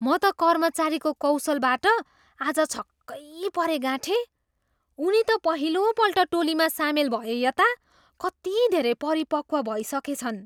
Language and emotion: Nepali, surprised